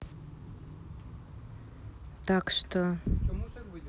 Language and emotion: Russian, neutral